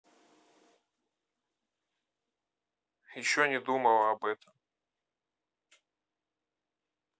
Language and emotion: Russian, neutral